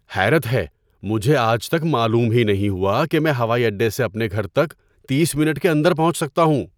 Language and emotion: Urdu, surprised